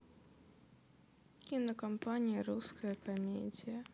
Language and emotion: Russian, sad